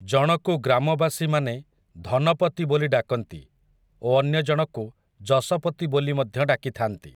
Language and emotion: Odia, neutral